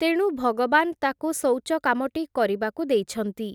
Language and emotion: Odia, neutral